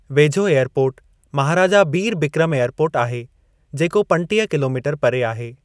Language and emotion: Sindhi, neutral